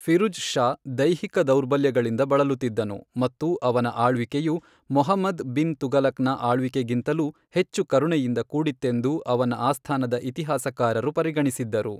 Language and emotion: Kannada, neutral